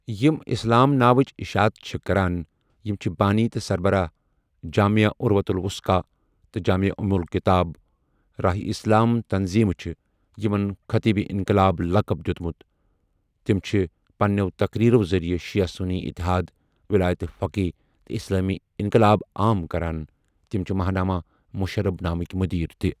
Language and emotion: Kashmiri, neutral